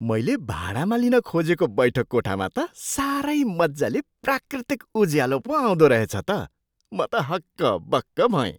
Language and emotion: Nepali, surprised